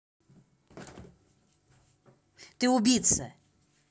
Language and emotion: Russian, angry